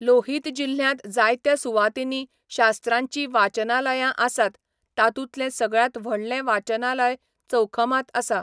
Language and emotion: Goan Konkani, neutral